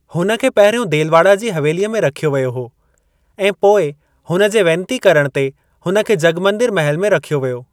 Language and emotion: Sindhi, neutral